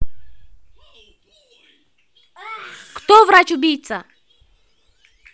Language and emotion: Russian, angry